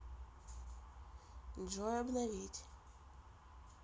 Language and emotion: Russian, neutral